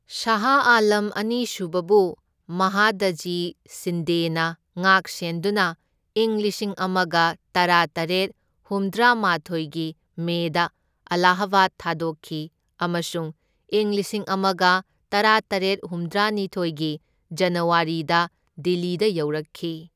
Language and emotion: Manipuri, neutral